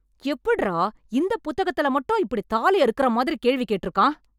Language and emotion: Tamil, angry